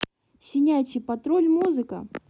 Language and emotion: Russian, positive